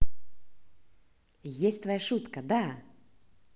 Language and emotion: Russian, positive